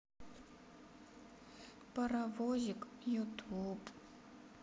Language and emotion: Russian, sad